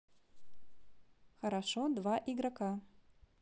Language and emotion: Russian, neutral